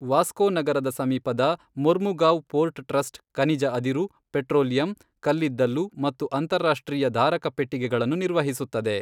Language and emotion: Kannada, neutral